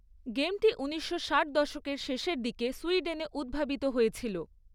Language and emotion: Bengali, neutral